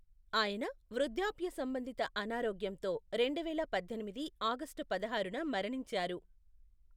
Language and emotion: Telugu, neutral